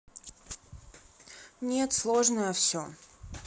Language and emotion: Russian, neutral